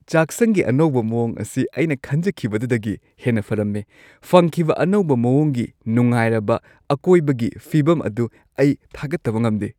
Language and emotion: Manipuri, happy